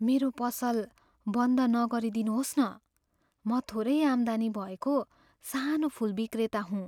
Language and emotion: Nepali, fearful